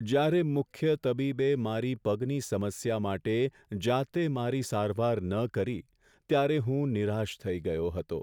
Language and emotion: Gujarati, sad